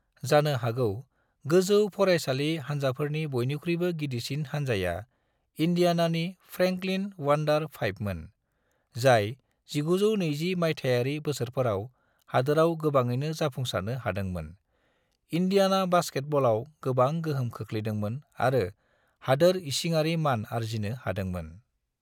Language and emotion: Bodo, neutral